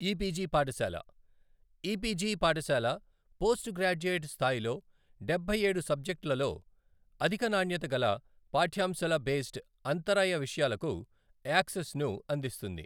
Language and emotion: Telugu, neutral